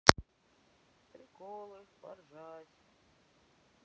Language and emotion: Russian, sad